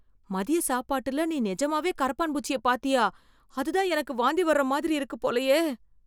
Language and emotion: Tamil, fearful